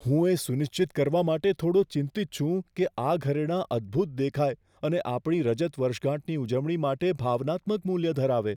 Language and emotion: Gujarati, fearful